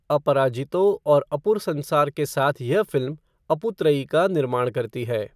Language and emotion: Hindi, neutral